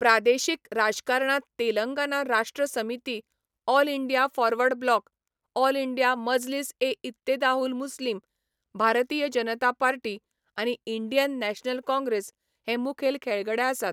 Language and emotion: Goan Konkani, neutral